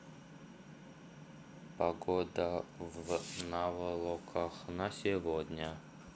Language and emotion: Russian, neutral